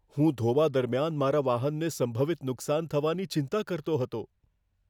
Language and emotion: Gujarati, fearful